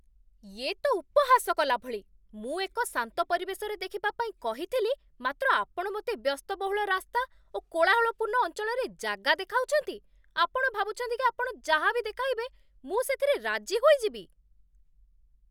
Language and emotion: Odia, angry